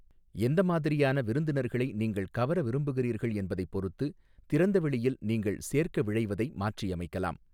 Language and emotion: Tamil, neutral